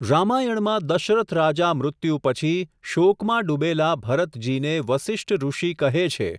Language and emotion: Gujarati, neutral